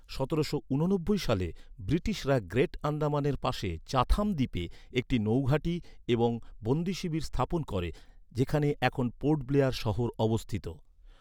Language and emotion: Bengali, neutral